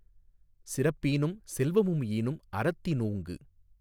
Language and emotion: Tamil, neutral